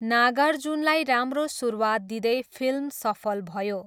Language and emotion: Nepali, neutral